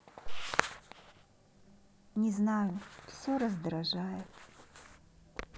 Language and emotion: Russian, sad